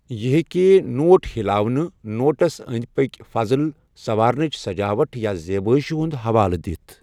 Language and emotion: Kashmiri, neutral